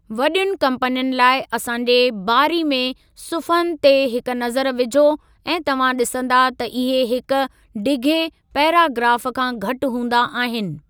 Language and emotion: Sindhi, neutral